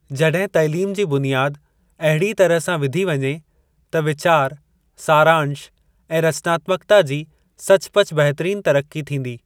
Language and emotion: Sindhi, neutral